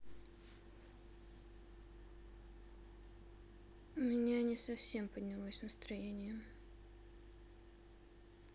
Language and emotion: Russian, sad